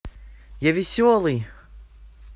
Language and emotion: Russian, positive